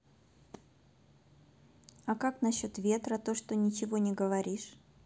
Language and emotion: Russian, neutral